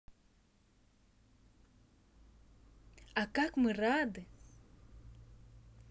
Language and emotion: Russian, positive